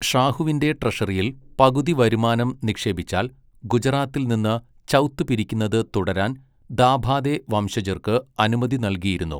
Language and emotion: Malayalam, neutral